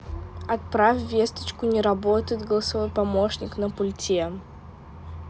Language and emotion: Russian, neutral